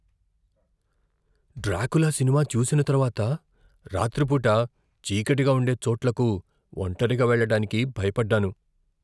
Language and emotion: Telugu, fearful